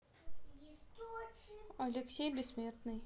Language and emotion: Russian, neutral